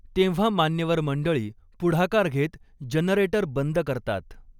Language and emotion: Marathi, neutral